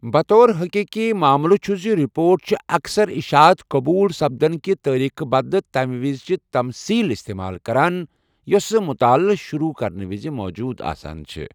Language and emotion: Kashmiri, neutral